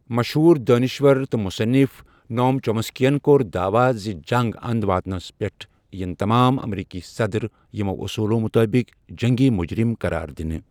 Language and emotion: Kashmiri, neutral